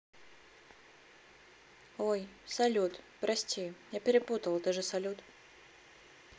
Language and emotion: Russian, neutral